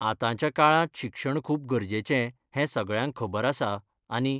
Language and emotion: Goan Konkani, neutral